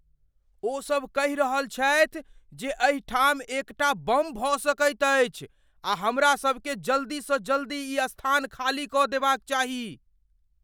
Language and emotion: Maithili, fearful